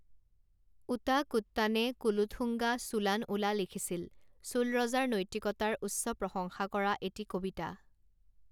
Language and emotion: Assamese, neutral